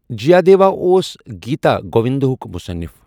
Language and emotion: Kashmiri, neutral